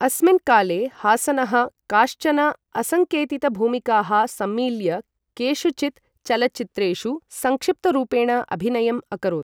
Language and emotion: Sanskrit, neutral